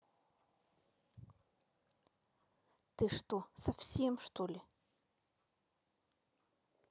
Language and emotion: Russian, angry